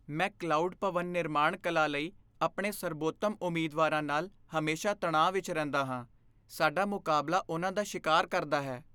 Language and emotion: Punjabi, fearful